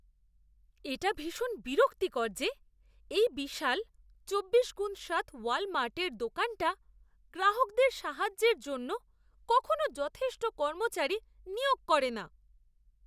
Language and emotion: Bengali, disgusted